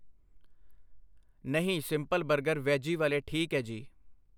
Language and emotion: Punjabi, neutral